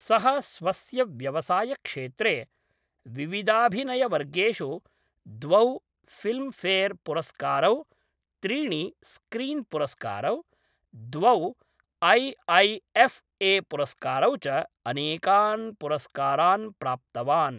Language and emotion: Sanskrit, neutral